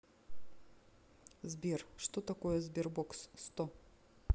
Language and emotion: Russian, neutral